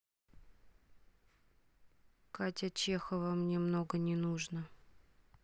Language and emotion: Russian, sad